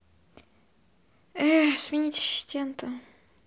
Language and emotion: Russian, sad